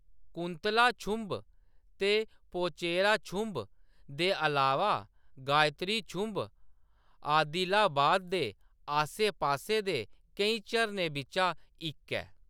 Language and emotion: Dogri, neutral